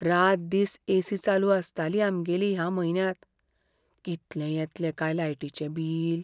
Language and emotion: Goan Konkani, fearful